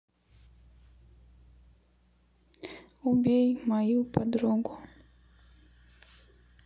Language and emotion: Russian, neutral